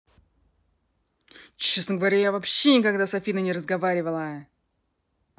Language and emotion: Russian, angry